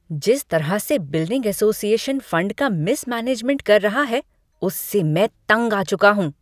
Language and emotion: Hindi, angry